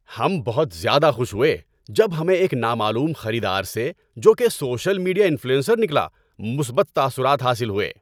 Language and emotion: Urdu, happy